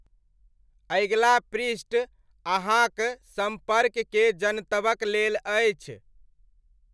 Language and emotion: Maithili, neutral